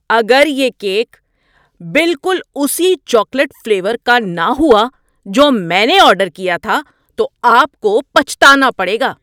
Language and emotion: Urdu, angry